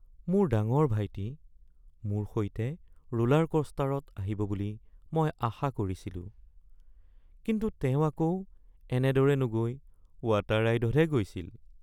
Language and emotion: Assamese, sad